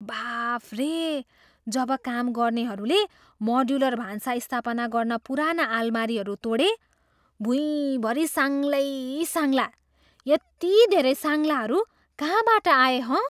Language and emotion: Nepali, surprised